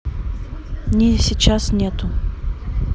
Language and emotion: Russian, neutral